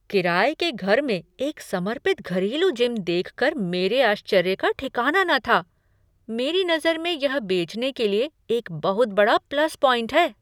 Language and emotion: Hindi, surprised